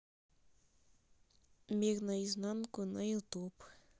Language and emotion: Russian, neutral